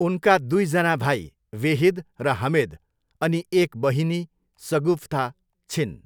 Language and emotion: Nepali, neutral